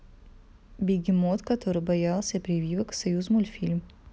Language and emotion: Russian, neutral